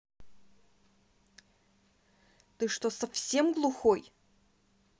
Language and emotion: Russian, angry